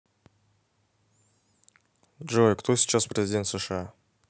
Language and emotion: Russian, neutral